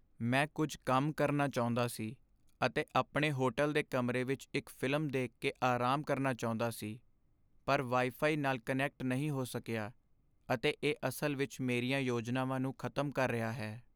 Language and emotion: Punjabi, sad